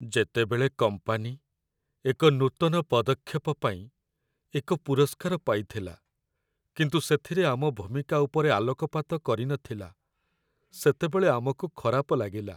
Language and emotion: Odia, sad